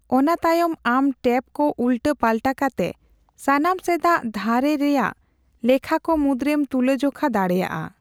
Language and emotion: Santali, neutral